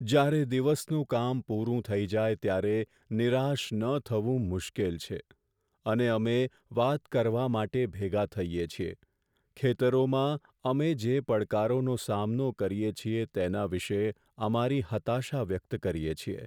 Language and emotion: Gujarati, sad